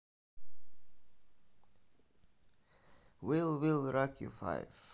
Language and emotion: Russian, neutral